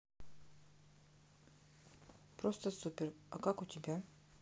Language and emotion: Russian, neutral